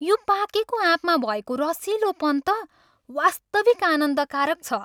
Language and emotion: Nepali, happy